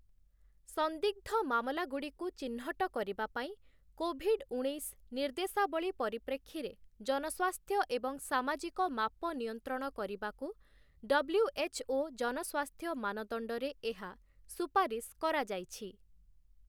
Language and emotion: Odia, neutral